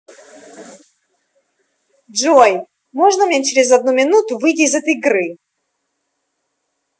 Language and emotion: Russian, angry